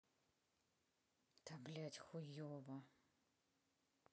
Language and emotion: Russian, angry